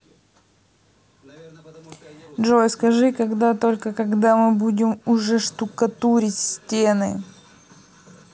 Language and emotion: Russian, neutral